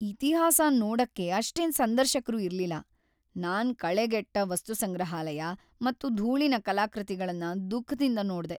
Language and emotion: Kannada, sad